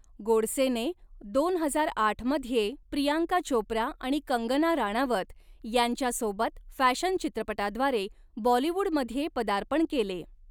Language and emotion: Marathi, neutral